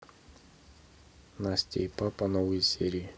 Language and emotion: Russian, neutral